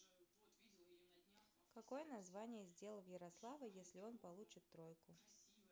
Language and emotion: Russian, neutral